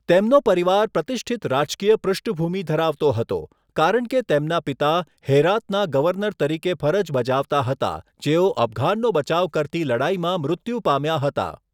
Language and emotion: Gujarati, neutral